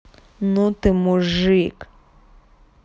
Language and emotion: Russian, angry